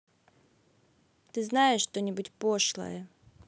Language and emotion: Russian, neutral